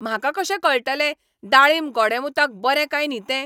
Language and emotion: Goan Konkani, angry